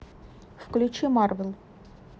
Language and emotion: Russian, neutral